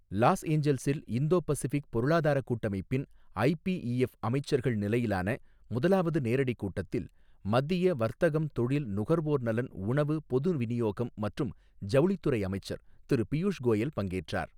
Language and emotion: Tamil, neutral